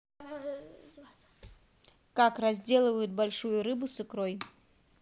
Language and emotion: Russian, neutral